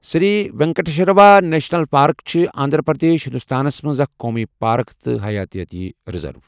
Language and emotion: Kashmiri, neutral